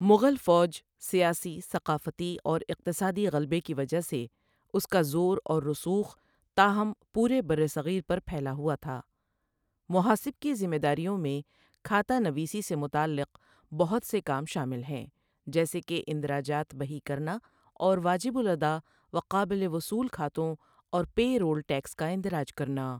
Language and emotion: Urdu, neutral